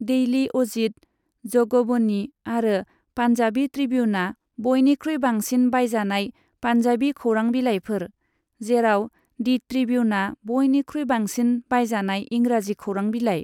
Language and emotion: Bodo, neutral